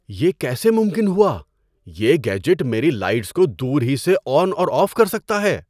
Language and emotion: Urdu, surprised